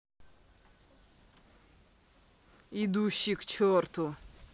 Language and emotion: Russian, angry